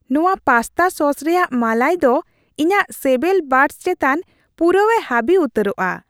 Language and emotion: Santali, happy